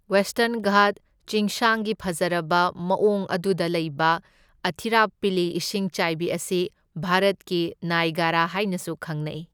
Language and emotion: Manipuri, neutral